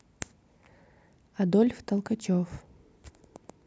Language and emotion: Russian, neutral